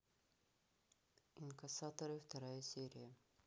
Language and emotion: Russian, neutral